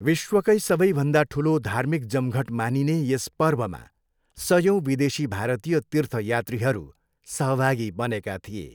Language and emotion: Nepali, neutral